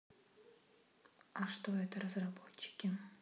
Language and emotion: Russian, neutral